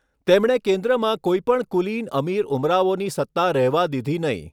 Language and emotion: Gujarati, neutral